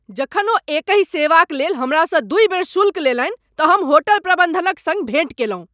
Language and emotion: Maithili, angry